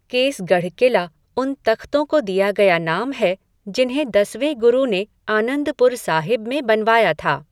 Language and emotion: Hindi, neutral